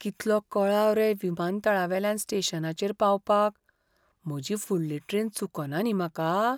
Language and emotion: Goan Konkani, fearful